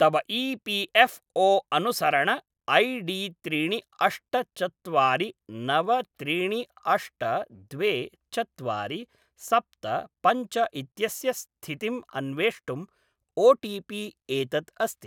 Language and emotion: Sanskrit, neutral